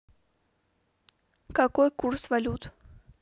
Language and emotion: Russian, neutral